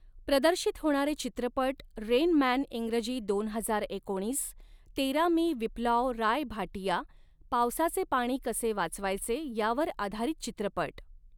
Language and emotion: Marathi, neutral